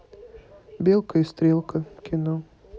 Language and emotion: Russian, neutral